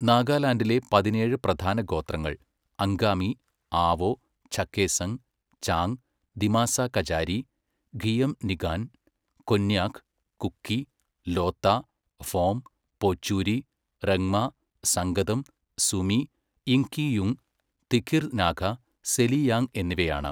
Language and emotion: Malayalam, neutral